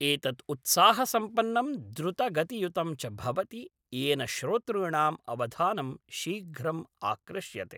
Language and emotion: Sanskrit, neutral